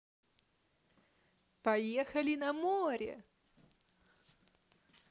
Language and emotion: Russian, positive